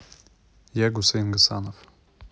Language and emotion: Russian, neutral